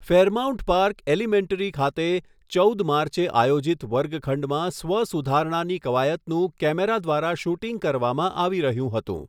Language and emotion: Gujarati, neutral